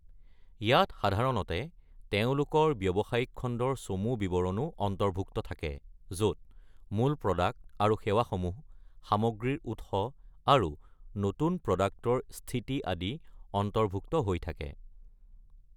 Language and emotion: Assamese, neutral